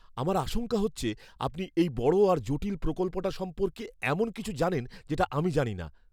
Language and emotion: Bengali, fearful